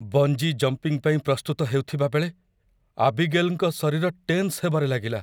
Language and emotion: Odia, fearful